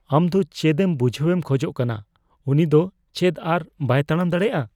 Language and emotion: Santali, fearful